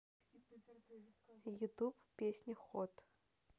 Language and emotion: Russian, neutral